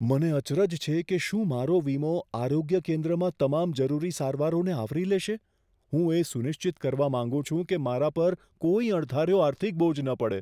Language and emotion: Gujarati, fearful